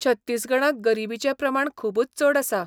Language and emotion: Goan Konkani, neutral